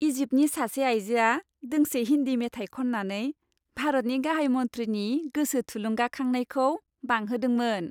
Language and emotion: Bodo, happy